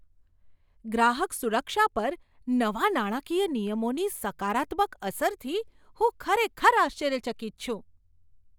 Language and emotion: Gujarati, surprised